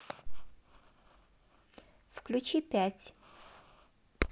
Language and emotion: Russian, neutral